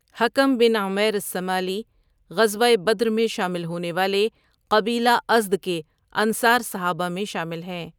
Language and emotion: Urdu, neutral